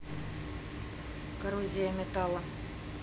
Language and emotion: Russian, neutral